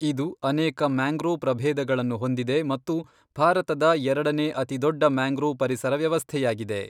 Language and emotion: Kannada, neutral